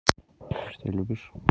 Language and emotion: Russian, neutral